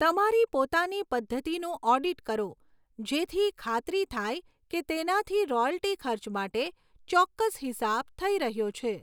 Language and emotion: Gujarati, neutral